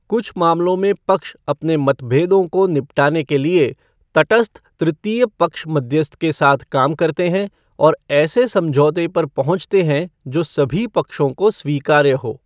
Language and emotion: Hindi, neutral